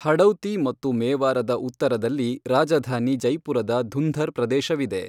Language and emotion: Kannada, neutral